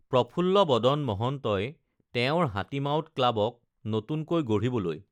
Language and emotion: Assamese, neutral